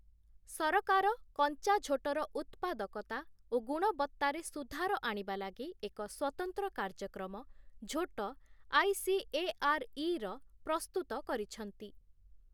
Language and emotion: Odia, neutral